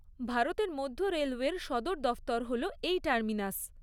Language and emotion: Bengali, neutral